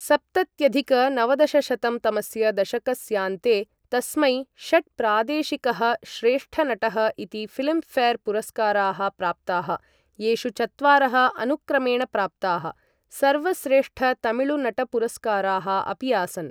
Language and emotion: Sanskrit, neutral